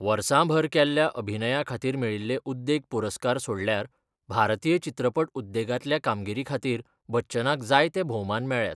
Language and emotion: Goan Konkani, neutral